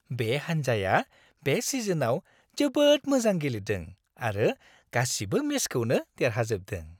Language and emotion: Bodo, happy